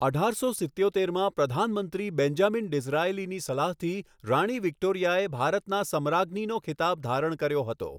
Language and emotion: Gujarati, neutral